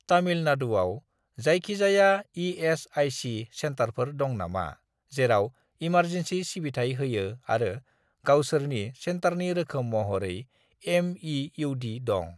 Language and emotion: Bodo, neutral